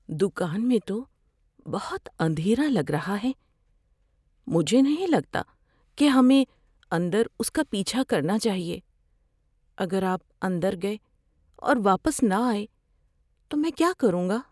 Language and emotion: Urdu, fearful